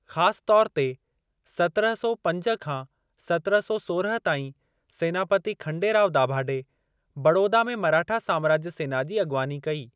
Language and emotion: Sindhi, neutral